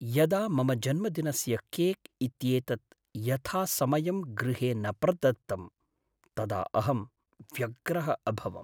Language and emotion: Sanskrit, sad